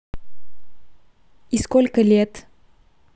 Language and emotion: Russian, neutral